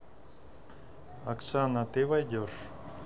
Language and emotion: Russian, neutral